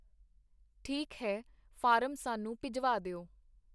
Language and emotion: Punjabi, neutral